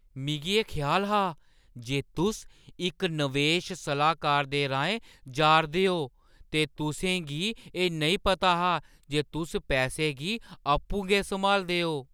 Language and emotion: Dogri, surprised